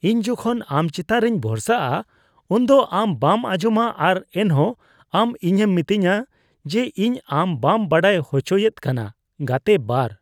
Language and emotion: Santali, disgusted